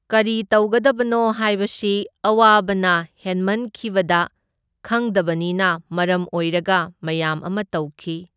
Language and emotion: Manipuri, neutral